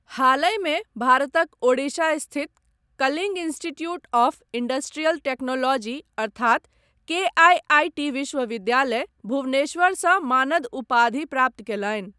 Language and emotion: Maithili, neutral